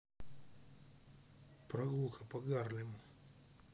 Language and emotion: Russian, neutral